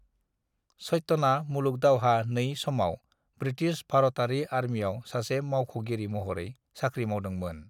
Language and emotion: Bodo, neutral